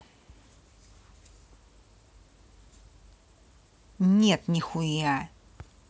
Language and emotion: Russian, angry